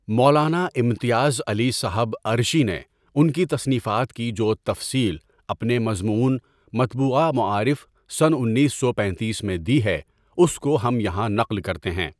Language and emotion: Urdu, neutral